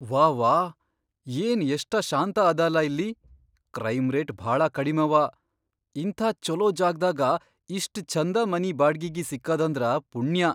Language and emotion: Kannada, surprised